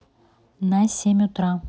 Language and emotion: Russian, neutral